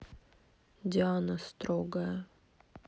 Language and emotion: Russian, neutral